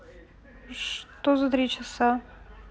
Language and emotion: Russian, neutral